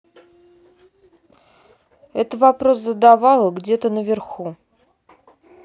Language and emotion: Russian, neutral